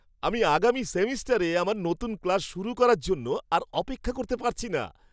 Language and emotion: Bengali, happy